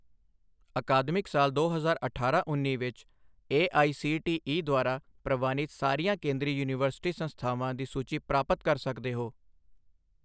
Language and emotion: Punjabi, neutral